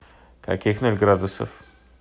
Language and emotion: Russian, neutral